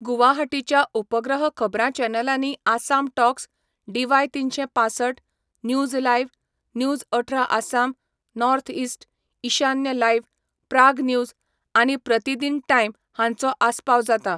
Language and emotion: Goan Konkani, neutral